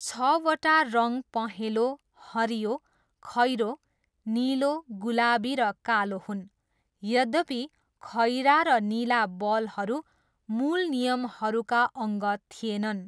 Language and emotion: Nepali, neutral